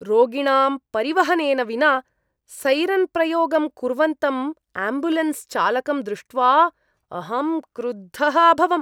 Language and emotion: Sanskrit, disgusted